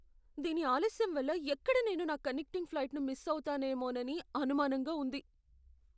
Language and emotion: Telugu, fearful